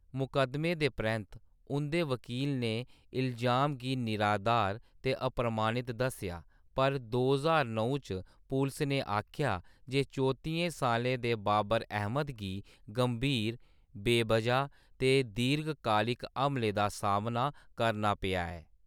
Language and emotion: Dogri, neutral